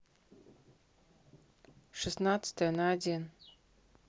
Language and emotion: Russian, neutral